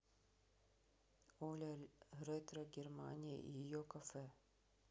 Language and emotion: Russian, neutral